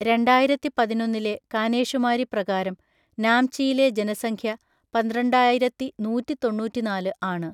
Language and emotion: Malayalam, neutral